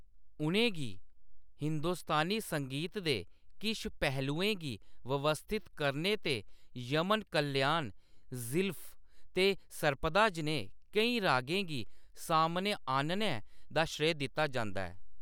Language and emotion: Dogri, neutral